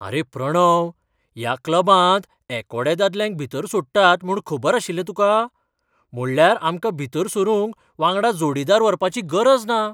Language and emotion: Goan Konkani, surprised